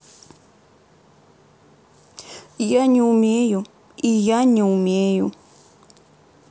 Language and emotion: Russian, sad